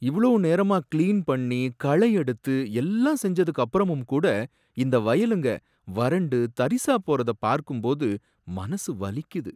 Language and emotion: Tamil, sad